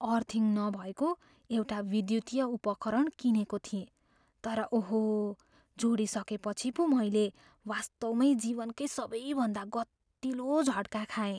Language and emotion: Nepali, fearful